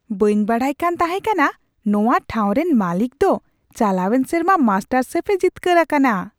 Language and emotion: Santali, surprised